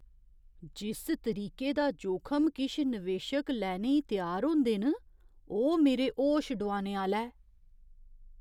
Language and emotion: Dogri, surprised